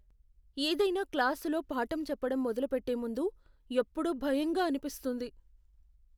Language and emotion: Telugu, fearful